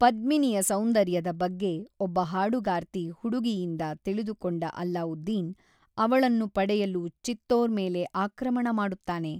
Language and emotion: Kannada, neutral